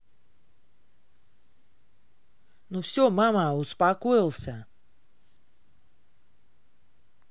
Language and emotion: Russian, angry